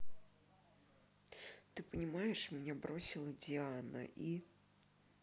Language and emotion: Russian, sad